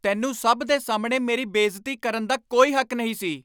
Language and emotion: Punjabi, angry